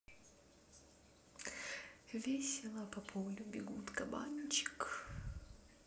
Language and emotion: Russian, neutral